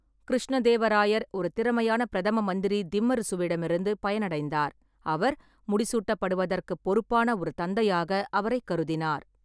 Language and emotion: Tamil, neutral